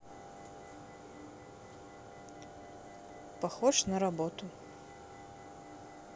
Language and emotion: Russian, neutral